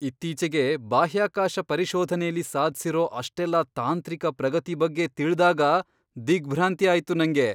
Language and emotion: Kannada, surprised